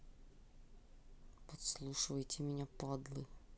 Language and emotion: Russian, angry